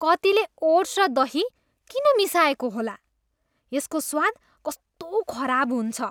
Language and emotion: Nepali, disgusted